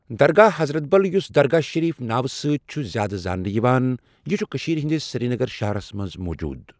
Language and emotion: Kashmiri, neutral